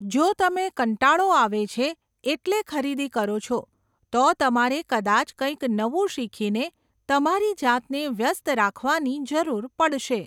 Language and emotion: Gujarati, neutral